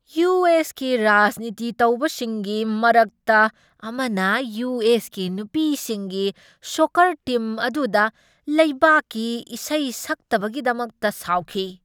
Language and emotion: Manipuri, angry